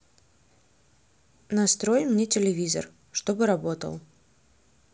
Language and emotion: Russian, neutral